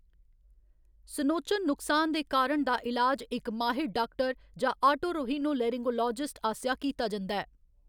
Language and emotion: Dogri, neutral